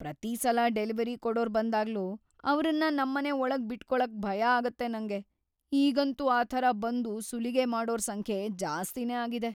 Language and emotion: Kannada, fearful